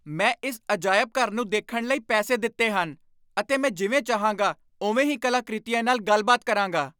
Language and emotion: Punjabi, angry